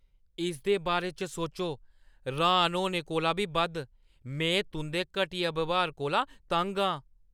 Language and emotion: Dogri, angry